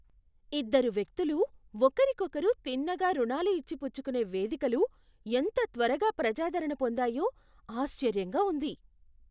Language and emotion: Telugu, surprised